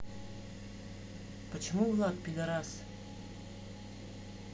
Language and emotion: Russian, neutral